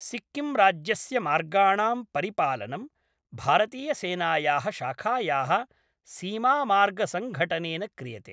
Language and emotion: Sanskrit, neutral